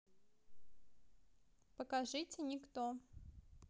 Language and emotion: Russian, neutral